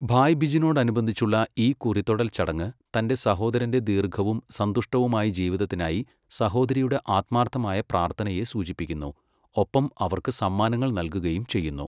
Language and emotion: Malayalam, neutral